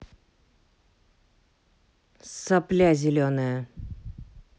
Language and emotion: Russian, angry